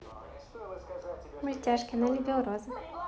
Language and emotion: Russian, positive